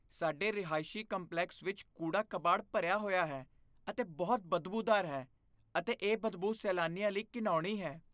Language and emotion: Punjabi, disgusted